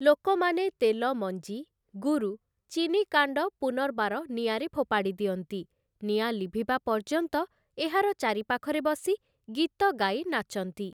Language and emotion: Odia, neutral